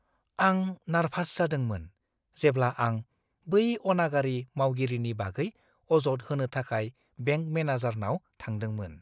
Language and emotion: Bodo, fearful